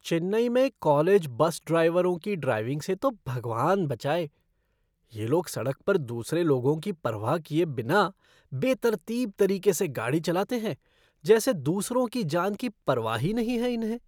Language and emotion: Hindi, disgusted